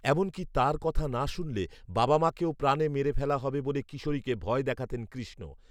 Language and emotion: Bengali, neutral